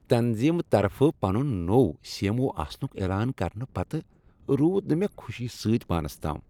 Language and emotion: Kashmiri, happy